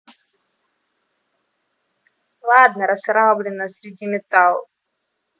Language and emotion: Russian, neutral